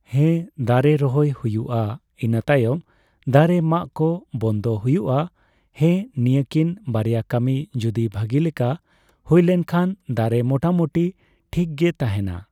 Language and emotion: Santali, neutral